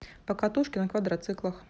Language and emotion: Russian, neutral